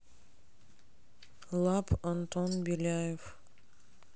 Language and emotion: Russian, neutral